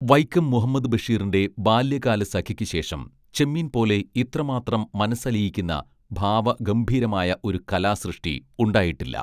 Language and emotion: Malayalam, neutral